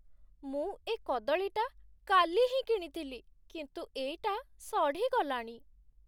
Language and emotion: Odia, sad